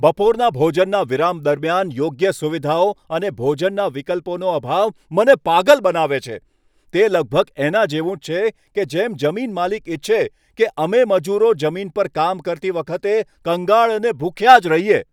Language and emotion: Gujarati, angry